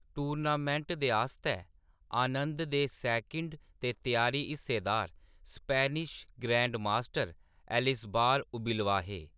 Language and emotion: Dogri, neutral